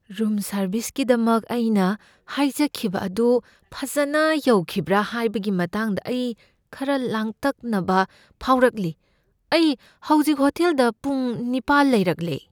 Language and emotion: Manipuri, fearful